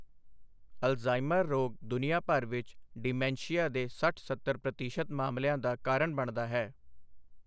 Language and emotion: Punjabi, neutral